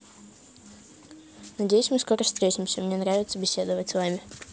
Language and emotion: Russian, neutral